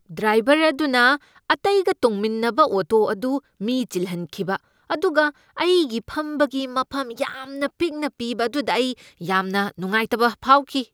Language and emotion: Manipuri, angry